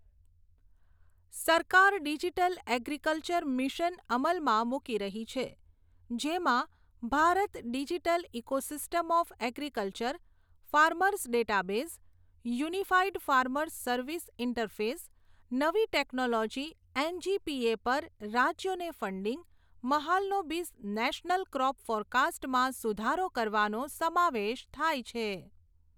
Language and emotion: Gujarati, neutral